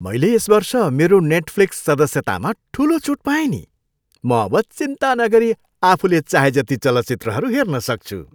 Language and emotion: Nepali, happy